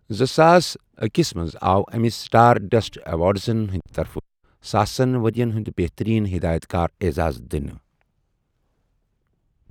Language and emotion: Kashmiri, neutral